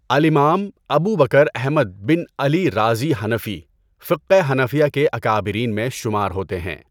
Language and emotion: Urdu, neutral